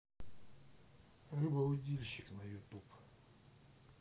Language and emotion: Russian, neutral